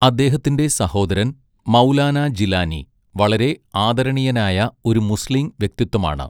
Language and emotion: Malayalam, neutral